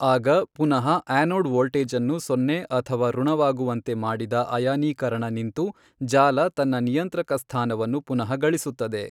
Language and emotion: Kannada, neutral